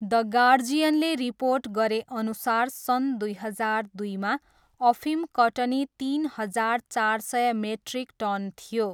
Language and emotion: Nepali, neutral